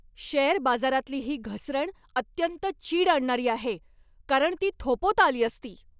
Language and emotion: Marathi, angry